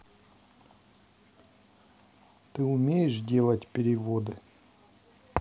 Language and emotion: Russian, neutral